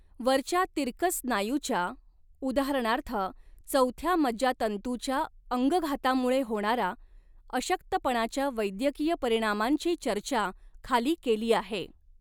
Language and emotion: Marathi, neutral